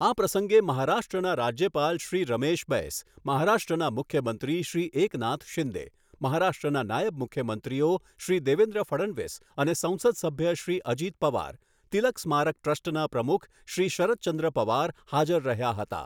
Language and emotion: Gujarati, neutral